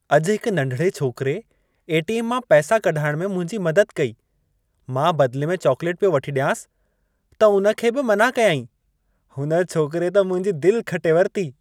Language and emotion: Sindhi, happy